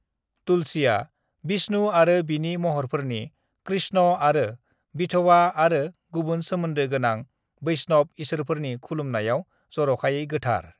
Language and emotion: Bodo, neutral